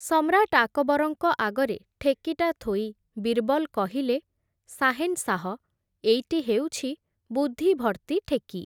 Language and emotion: Odia, neutral